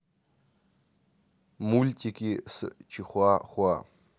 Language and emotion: Russian, neutral